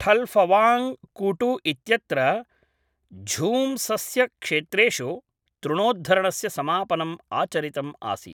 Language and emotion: Sanskrit, neutral